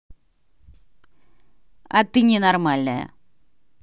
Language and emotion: Russian, angry